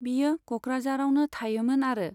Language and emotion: Bodo, neutral